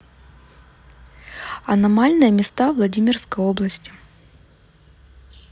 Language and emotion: Russian, neutral